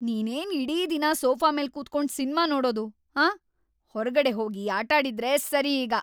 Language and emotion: Kannada, angry